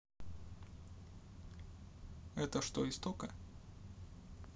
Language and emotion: Russian, neutral